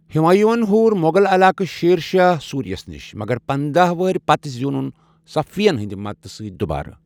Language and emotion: Kashmiri, neutral